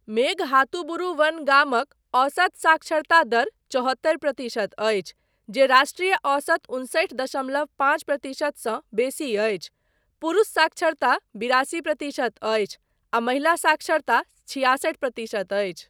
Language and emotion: Maithili, neutral